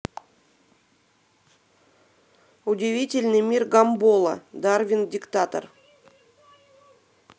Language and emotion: Russian, neutral